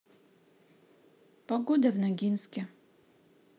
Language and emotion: Russian, neutral